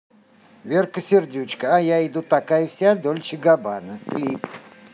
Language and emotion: Russian, neutral